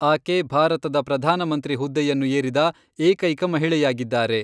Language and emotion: Kannada, neutral